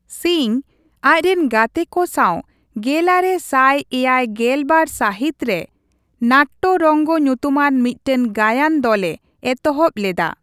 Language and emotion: Santali, neutral